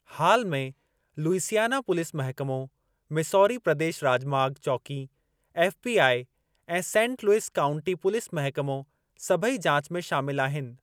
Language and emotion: Sindhi, neutral